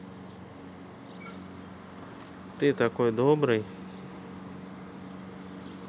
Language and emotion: Russian, neutral